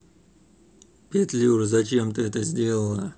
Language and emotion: Russian, neutral